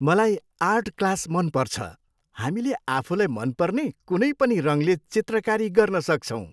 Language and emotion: Nepali, happy